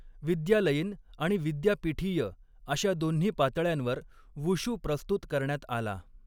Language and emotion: Marathi, neutral